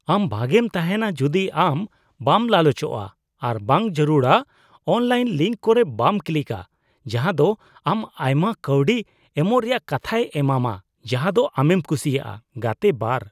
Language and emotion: Santali, disgusted